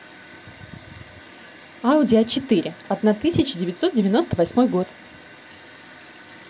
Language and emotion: Russian, positive